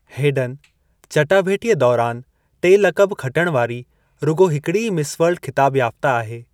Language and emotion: Sindhi, neutral